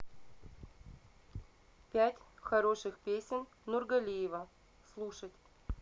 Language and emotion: Russian, neutral